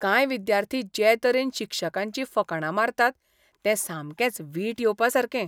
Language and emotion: Goan Konkani, disgusted